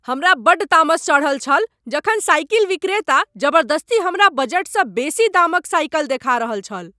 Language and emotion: Maithili, angry